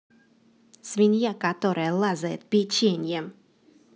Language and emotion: Russian, angry